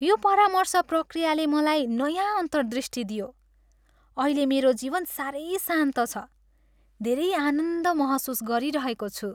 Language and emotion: Nepali, happy